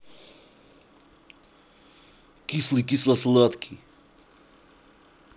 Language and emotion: Russian, angry